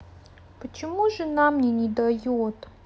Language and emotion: Russian, sad